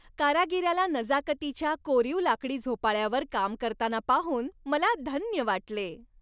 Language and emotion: Marathi, happy